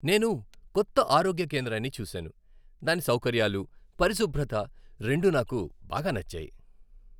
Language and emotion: Telugu, happy